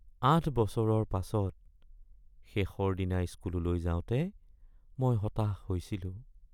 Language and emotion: Assamese, sad